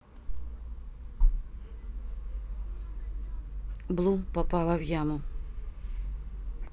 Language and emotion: Russian, neutral